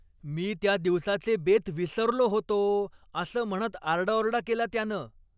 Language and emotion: Marathi, angry